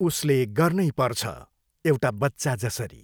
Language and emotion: Nepali, neutral